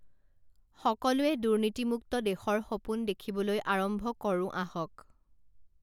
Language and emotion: Assamese, neutral